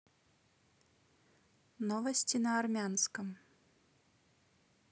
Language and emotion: Russian, neutral